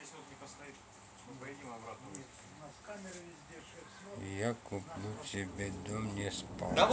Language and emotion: Russian, sad